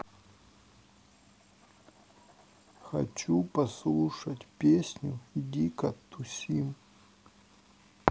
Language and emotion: Russian, sad